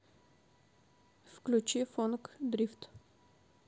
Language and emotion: Russian, neutral